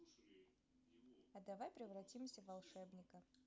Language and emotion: Russian, positive